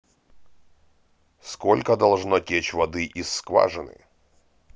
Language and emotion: Russian, neutral